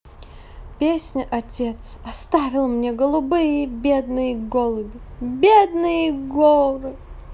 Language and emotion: Russian, sad